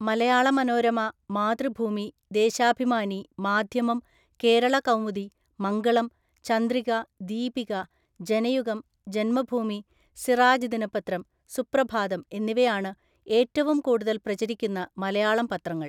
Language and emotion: Malayalam, neutral